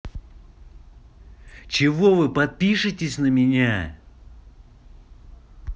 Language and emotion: Russian, angry